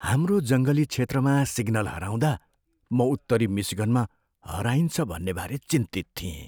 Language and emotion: Nepali, fearful